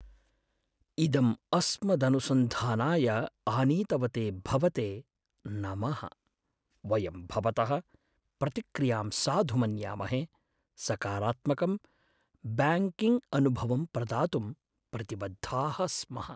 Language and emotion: Sanskrit, sad